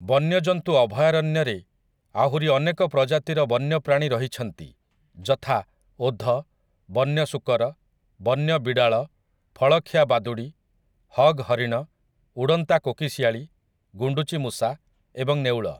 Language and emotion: Odia, neutral